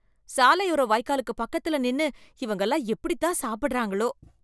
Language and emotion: Tamil, disgusted